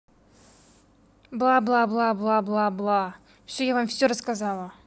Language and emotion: Russian, angry